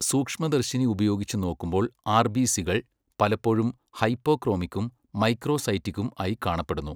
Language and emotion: Malayalam, neutral